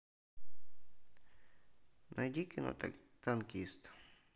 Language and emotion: Russian, neutral